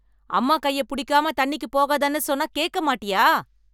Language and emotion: Tamil, angry